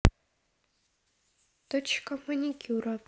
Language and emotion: Russian, neutral